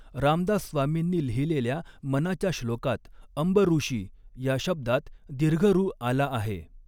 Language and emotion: Marathi, neutral